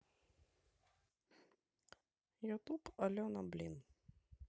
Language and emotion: Russian, neutral